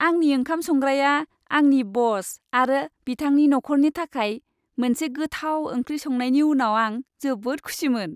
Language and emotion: Bodo, happy